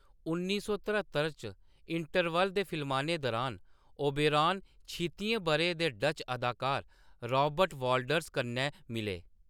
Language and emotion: Dogri, neutral